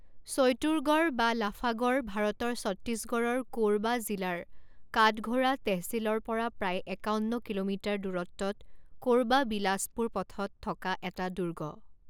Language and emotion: Assamese, neutral